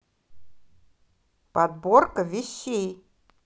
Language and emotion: Russian, positive